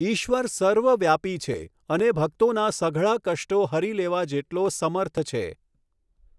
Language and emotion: Gujarati, neutral